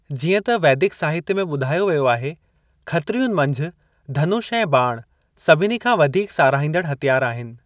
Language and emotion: Sindhi, neutral